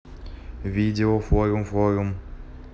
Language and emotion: Russian, neutral